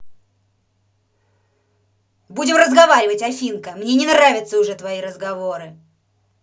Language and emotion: Russian, angry